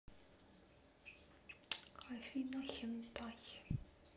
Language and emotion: Russian, neutral